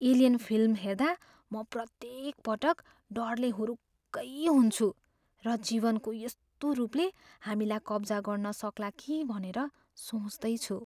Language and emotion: Nepali, fearful